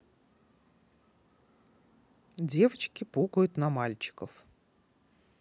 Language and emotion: Russian, neutral